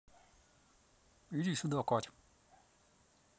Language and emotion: Russian, neutral